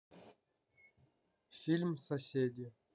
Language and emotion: Russian, neutral